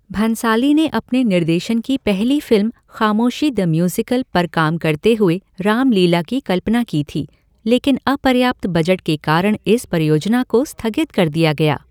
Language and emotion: Hindi, neutral